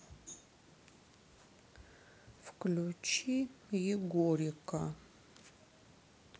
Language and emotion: Russian, sad